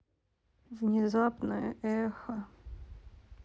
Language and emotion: Russian, sad